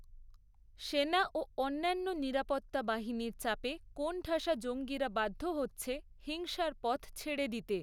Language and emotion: Bengali, neutral